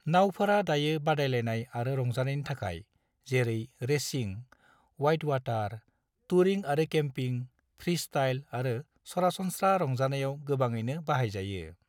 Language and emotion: Bodo, neutral